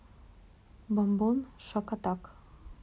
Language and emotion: Russian, neutral